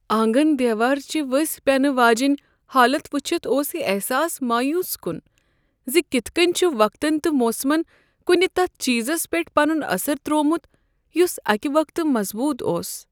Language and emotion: Kashmiri, sad